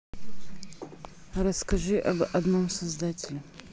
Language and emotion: Russian, neutral